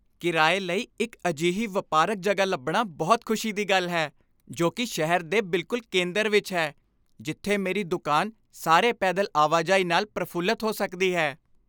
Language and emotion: Punjabi, happy